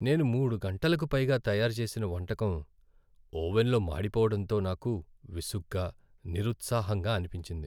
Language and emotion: Telugu, sad